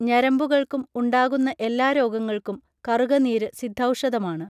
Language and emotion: Malayalam, neutral